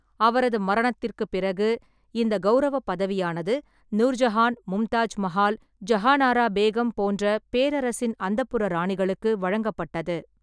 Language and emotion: Tamil, neutral